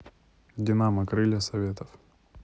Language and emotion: Russian, neutral